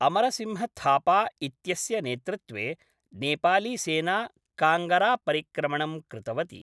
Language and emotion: Sanskrit, neutral